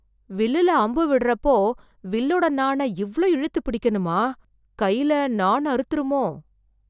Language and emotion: Tamil, fearful